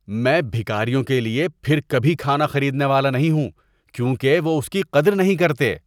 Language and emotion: Urdu, disgusted